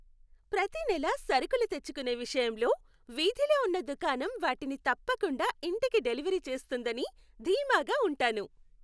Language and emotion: Telugu, happy